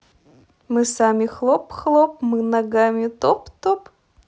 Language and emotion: Russian, positive